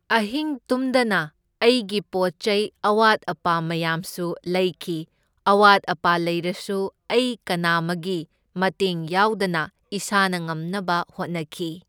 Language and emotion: Manipuri, neutral